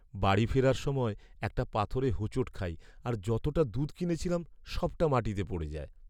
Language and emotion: Bengali, sad